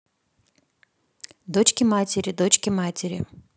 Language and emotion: Russian, neutral